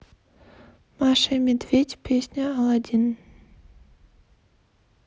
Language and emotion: Russian, neutral